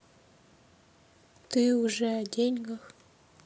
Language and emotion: Russian, sad